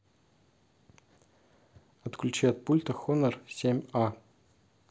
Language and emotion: Russian, neutral